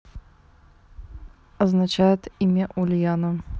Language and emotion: Russian, neutral